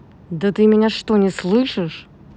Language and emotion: Russian, angry